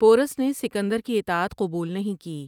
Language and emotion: Urdu, neutral